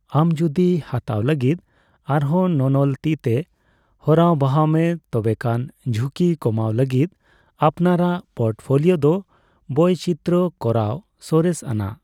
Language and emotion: Santali, neutral